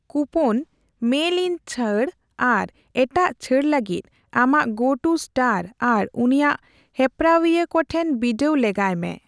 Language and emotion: Santali, neutral